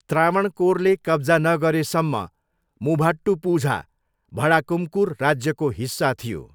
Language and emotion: Nepali, neutral